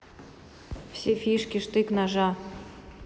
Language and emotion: Russian, neutral